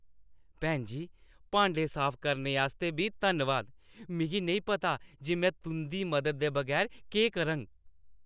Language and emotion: Dogri, happy